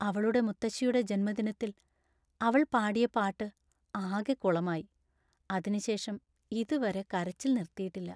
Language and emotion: Malayalam, sad